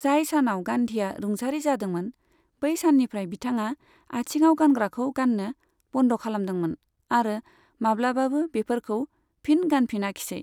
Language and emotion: Bodo, neutral